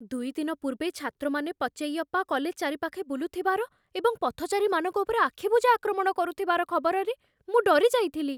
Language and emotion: Odia, fearful